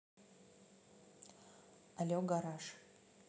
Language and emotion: Russian, neutral